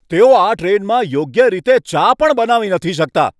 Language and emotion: Gujarati, angry